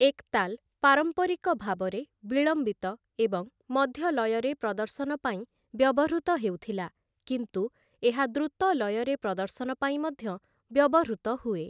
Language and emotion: Odia, neutral